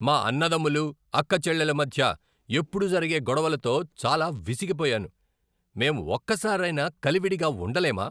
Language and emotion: Telugu, angry